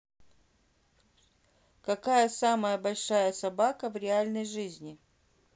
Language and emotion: Russian, neutral